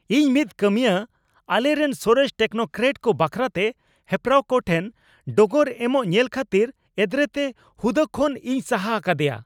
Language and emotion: Santali, angry